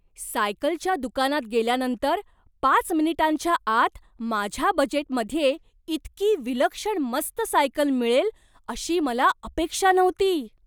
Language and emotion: Marathi, surprised